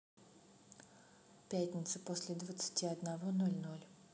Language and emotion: Russian, neutral